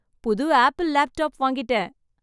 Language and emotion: Tamil, happy